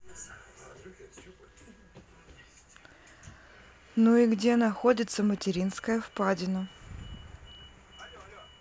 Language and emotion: Russian, neutral